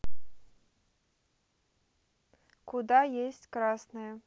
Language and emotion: Russian, neutral